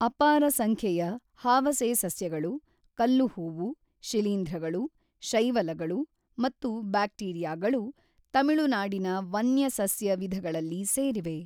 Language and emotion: Kannada, neutral